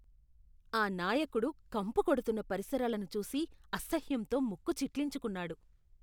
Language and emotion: Telugu, disgusted